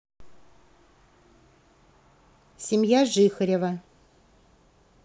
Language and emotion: Russian, neutral